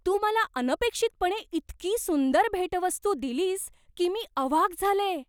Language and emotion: Marathi, surprised